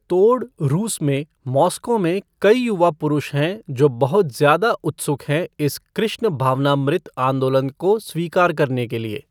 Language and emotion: Hindi, neutral